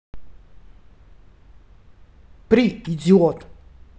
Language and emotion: Russian, angry